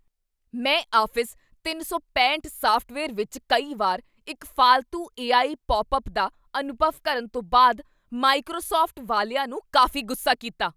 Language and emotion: Punjabi, angry